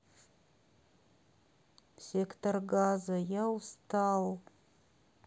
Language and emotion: Russian, sad